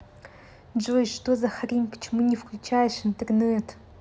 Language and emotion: Russian, angry